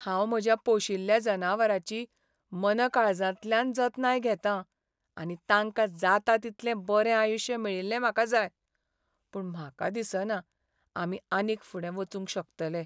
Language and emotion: Goan Konkani, sad